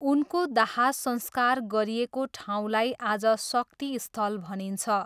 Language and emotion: Nepali, neutral